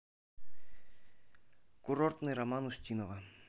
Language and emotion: Russian, neutral